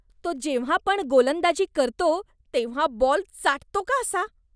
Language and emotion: Marathi, disgusted